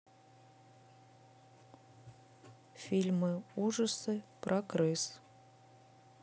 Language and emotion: Russian, neutral